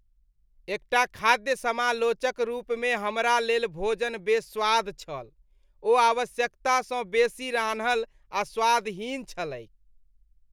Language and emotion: Maithili, disgusted